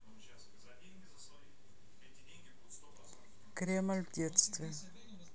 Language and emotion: Russian, neutral